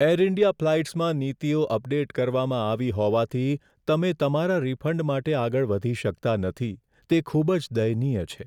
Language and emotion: Gujarati, sad